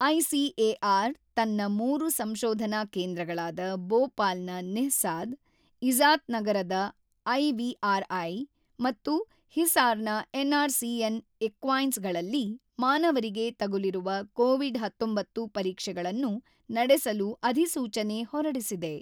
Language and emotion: Kannada, neutral